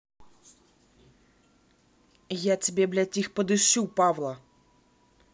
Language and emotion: Russian, angry